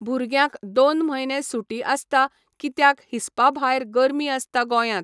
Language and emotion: Goan Konkani, neutral